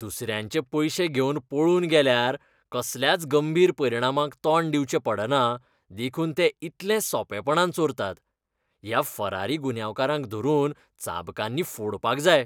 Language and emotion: Goan Konkani, disgusted